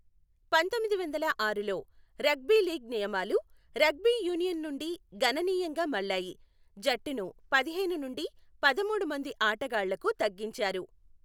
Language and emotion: Telugu, neutral